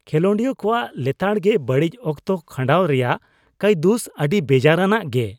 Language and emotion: Santali, disgusted